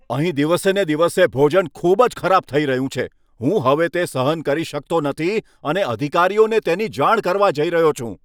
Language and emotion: Gujarati, angry